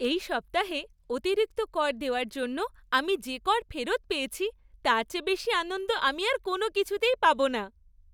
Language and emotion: Bengali, happy